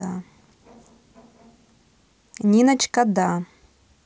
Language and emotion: Russian, positive